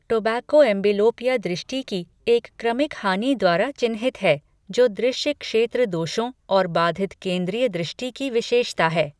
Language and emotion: Hindi, neutral